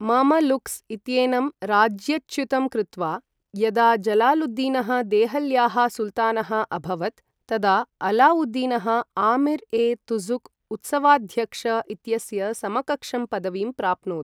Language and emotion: Sanskrit, neutral